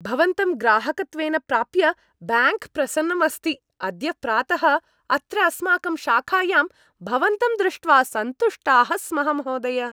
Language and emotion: Sanskrit, happy